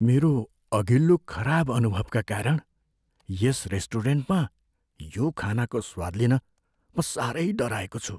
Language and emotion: Nepali, fearful